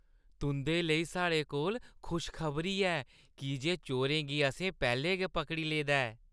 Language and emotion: Dogri, happy